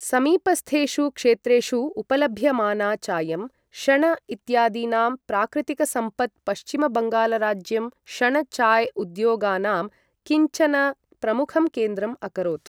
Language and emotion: Sanskrit, neutral